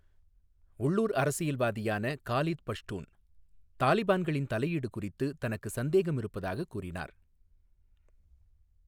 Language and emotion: Tamil, neutral